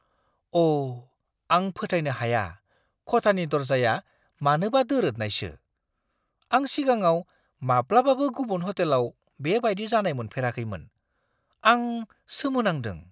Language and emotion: Bodo, surprised